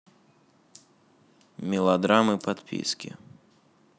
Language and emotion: Russian, sad